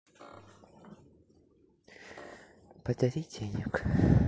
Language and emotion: Russian, sad